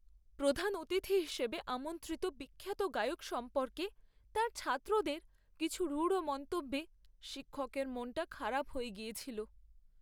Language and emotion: Bengali, sad